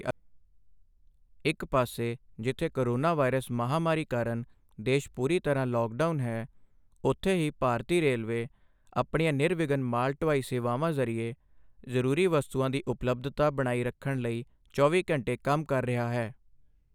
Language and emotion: Punjabi, neutral